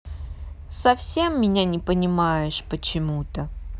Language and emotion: Russian, sad